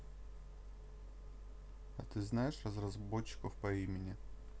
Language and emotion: Russian, neutral